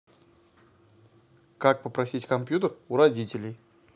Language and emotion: Russian, neutral